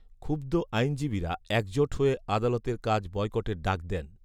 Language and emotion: Bengali, neutral